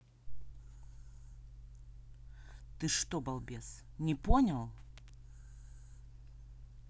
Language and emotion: Russian, angry